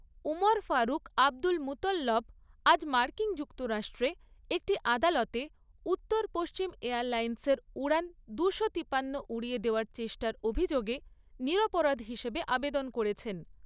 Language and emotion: Bengali, neutral